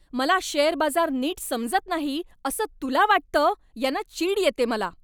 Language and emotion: Marathi, angry